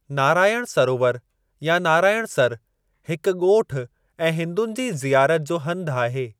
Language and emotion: Sindhi, neutral